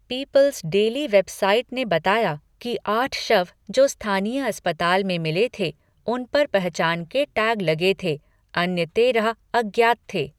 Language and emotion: Hindi, neutral